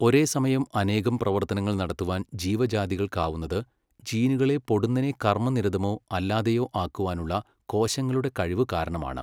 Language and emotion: Malayalam, neutral